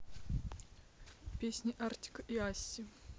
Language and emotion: Russian, neutral